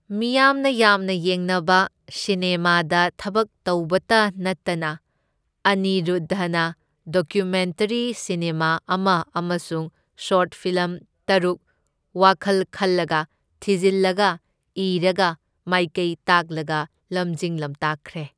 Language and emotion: Manipuri, neutral